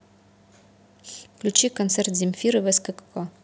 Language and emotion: Russian, neutral